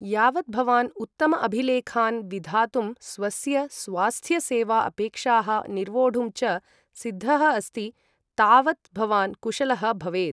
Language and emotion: Sanskrit, neutral